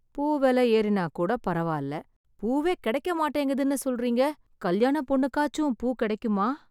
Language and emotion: Tamil, sad